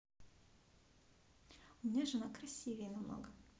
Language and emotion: Russian, neutral